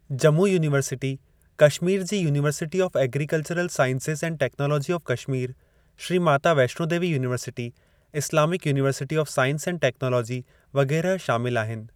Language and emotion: Sindhi, neutral